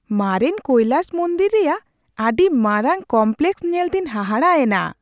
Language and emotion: Santali, surprised